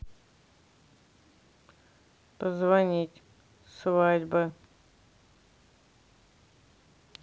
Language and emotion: Russian, neutral